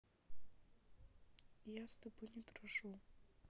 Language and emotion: Russian, neutral